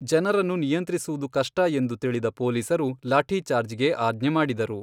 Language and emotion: Kannada, neutral